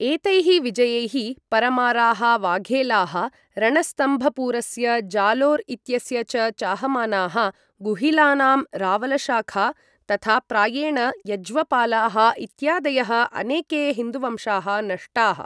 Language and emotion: Sanskrit, neutral